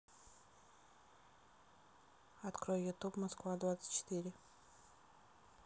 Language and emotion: Russian, neutral